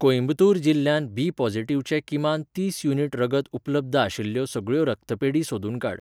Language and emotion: Goan Konkani, neutral